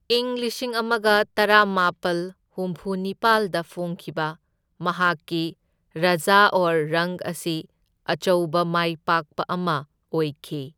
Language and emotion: Manipuri, neutral